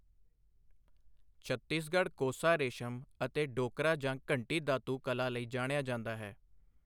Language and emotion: Punjabi, neutral